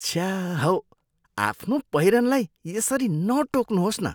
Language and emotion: Nepali, disgusted